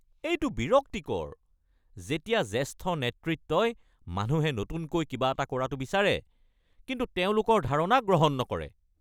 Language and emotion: Assamese, angry